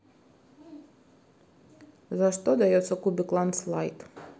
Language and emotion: Russian, neutral